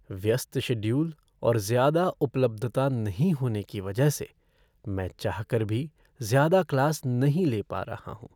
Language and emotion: Hindi, sad